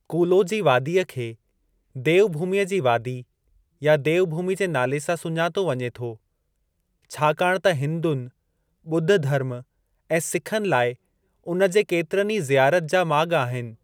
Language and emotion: Sindhi, neutral